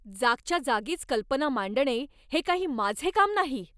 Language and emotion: Marathi, angry